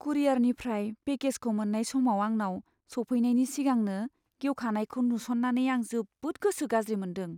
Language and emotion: Bodo, sad